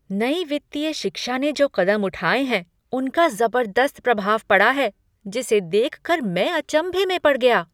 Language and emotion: Hindi, surprised